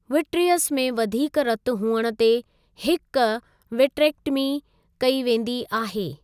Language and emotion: Sindhi, neutral